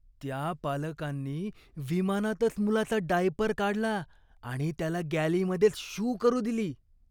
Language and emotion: Marathi, disgusted